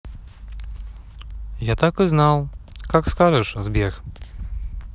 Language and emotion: Russian, neutral